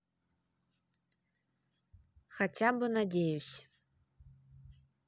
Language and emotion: Russian, neutral